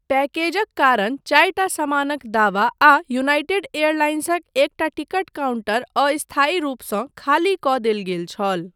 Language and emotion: Maithili, neutral